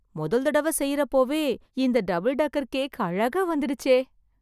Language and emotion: Tamil, surprised